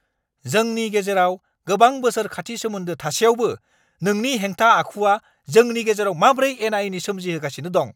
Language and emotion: Bodo, angry